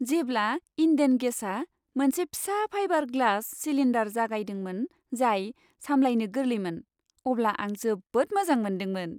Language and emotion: Bodo, happy